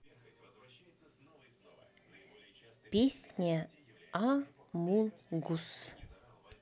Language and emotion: Russian, neutral